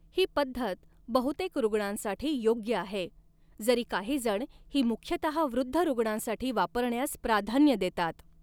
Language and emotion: Marathi, neutral